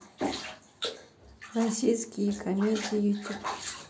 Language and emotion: Russian, neutral